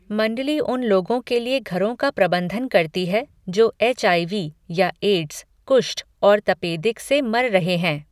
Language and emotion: Hindi, neutral